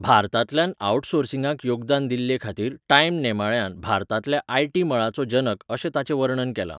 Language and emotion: Goan Konkani, neutral